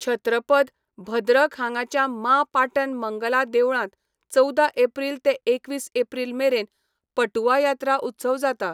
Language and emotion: Goan Konkani, neutral